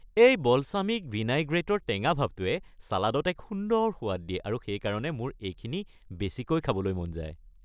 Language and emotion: Assamese, happy